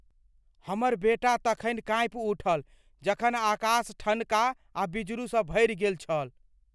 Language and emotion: Maithili, fearful